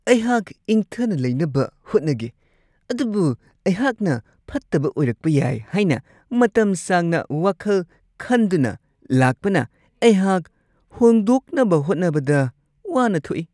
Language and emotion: Manipuri, disgusted